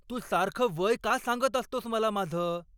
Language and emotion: Marathi, angry